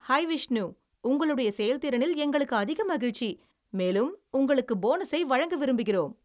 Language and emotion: Tamil, happy